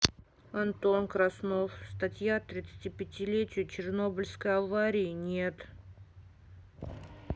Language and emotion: Russian, sad